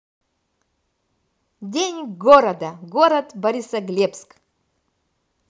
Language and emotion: Russian, positive